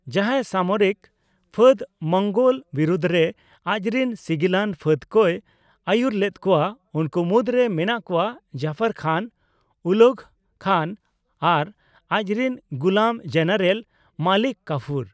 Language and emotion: Santali, neutral